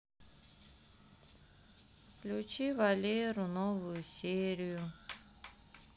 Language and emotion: Russian, sad